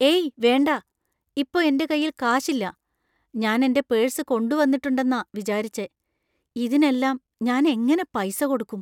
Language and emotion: Malayalam, fearful